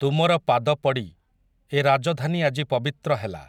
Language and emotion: Odia, neutral